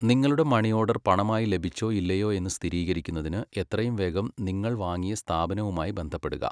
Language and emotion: Malayalam, neutral